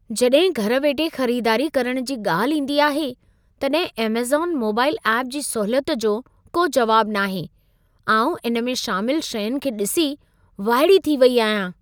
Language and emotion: Sindhi, surprised